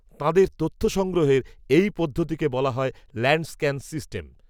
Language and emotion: Bengali, neutral